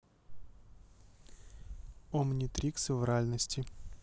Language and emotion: Russian, neutral